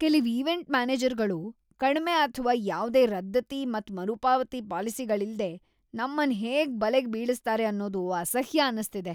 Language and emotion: Kannada, disgusted